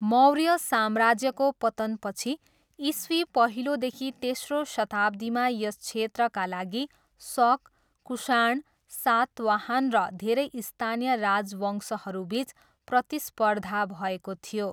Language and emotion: Nepali, neutral